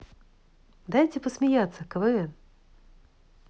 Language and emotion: Russian, positive